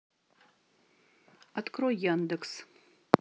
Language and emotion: Russian, neutral